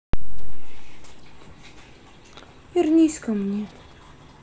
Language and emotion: Russian, sad